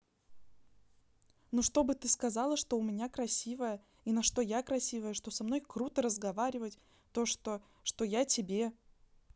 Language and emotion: Russian, neutral